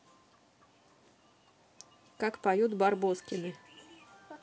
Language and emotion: Russian, neutral